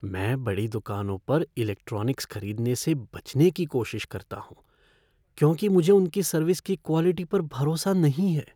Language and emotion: Hindi, fearful